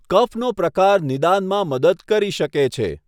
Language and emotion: Gujarati, neutral